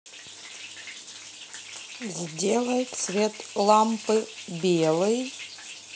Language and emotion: Russian, neutral